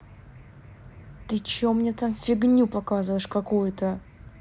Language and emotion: Russian, angry